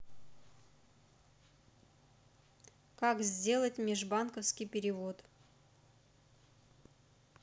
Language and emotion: Russian, neutral